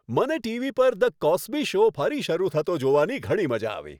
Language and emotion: Gujarati, happy